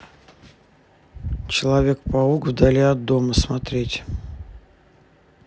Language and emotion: Russian, neutral